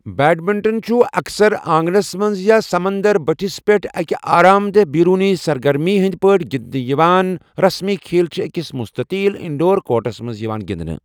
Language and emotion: Kashmiri, neutral